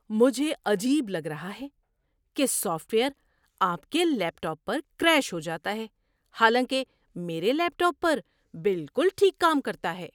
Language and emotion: Urdu, surprised